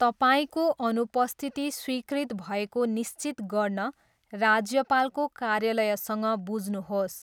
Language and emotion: Nepali, neutral